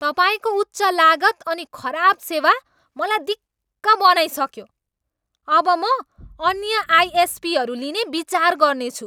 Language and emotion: Nepali, angry